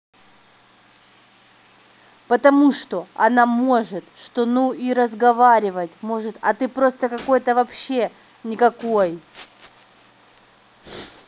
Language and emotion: Russian, angry